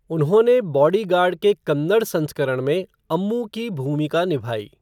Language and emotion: Hindi, neutral